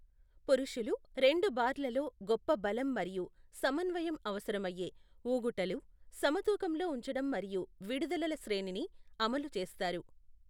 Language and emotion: Telugu, neutral